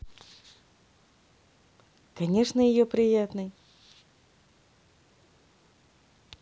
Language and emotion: Russian, positive